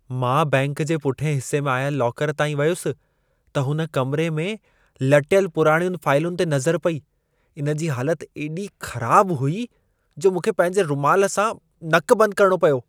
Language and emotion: Sindhi, disgusted